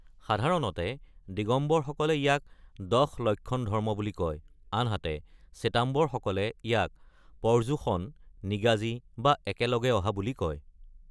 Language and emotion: Assamese, neutral